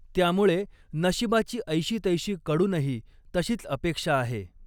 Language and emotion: Marathi, neutral